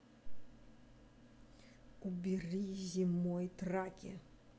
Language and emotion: Russian, angry